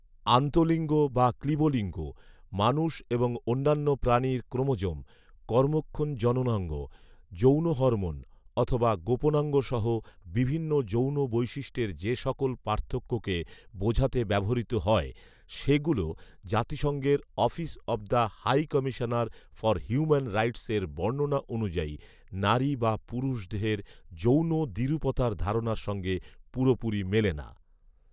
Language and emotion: Bengali, neutral